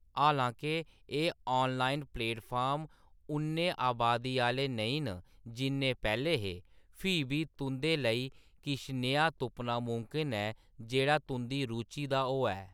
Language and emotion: Dogri, neutral